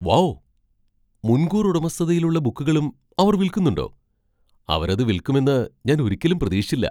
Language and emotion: Malayalam, surprised